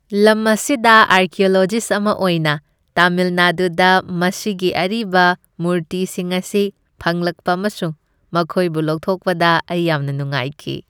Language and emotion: Manipuri, happy